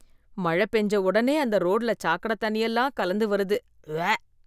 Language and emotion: Tamil, disgusted